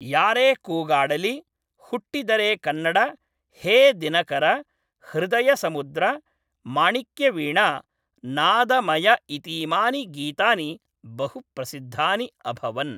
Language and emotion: Sanskrit, neutral